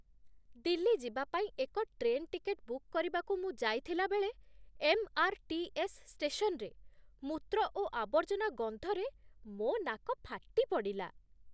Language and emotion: Odia, disgusted